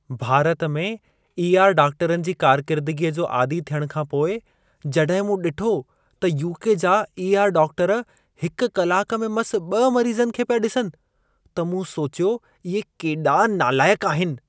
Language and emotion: Sindhi, disgusted